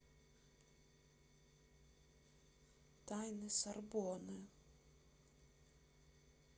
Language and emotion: Russian, sad